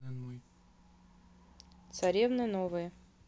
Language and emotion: Russian, neutral